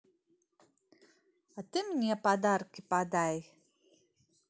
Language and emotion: Russian, positive